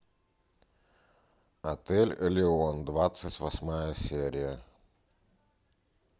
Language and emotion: Russian, neutral